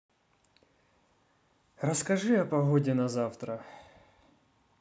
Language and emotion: Russian, neutral